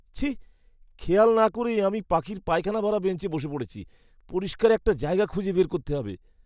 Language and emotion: Bengali, disgusted